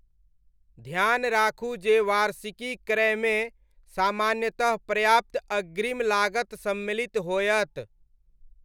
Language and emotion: Maithili, neutral